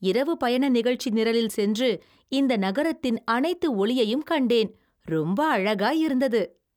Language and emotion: Tamil, happy